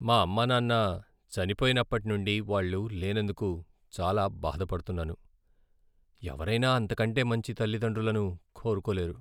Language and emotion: Telugu, sad